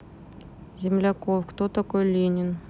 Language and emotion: Russian, neutral